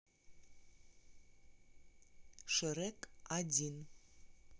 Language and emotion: Russian, neutral